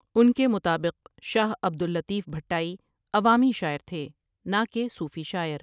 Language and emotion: Urdu, neutral